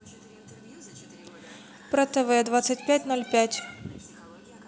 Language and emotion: Russian, neutral